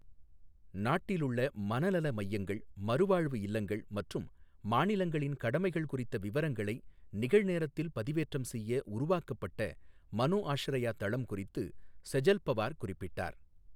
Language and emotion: Tamil, neutral